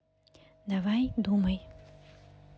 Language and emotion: Russian, neutral